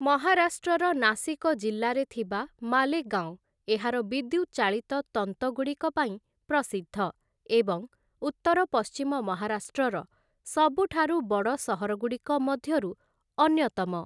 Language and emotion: Odia, neutral